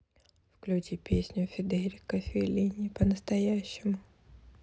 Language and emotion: Russian, neutral